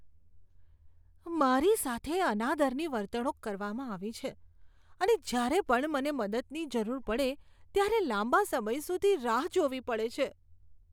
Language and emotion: Gujarati, disgusted